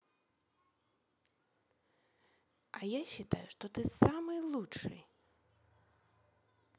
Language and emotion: Russian, positive